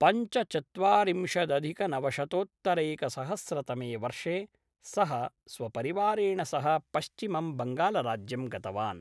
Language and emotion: Sanskrit, neutral